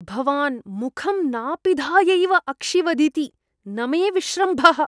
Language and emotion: Sanskrit, disgusted